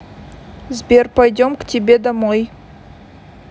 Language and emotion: Russian, neutral